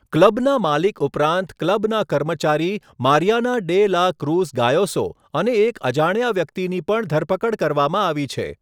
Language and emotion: Gujarati, neutral